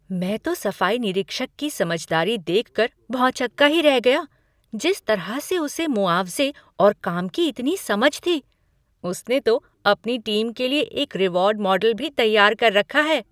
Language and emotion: Hindi, surprised